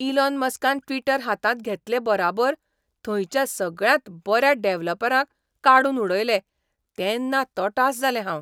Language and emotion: Goan Konkani, surprised